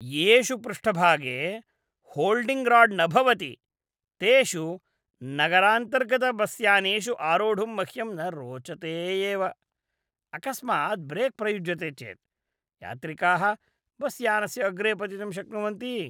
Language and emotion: Sanskrit, disgusted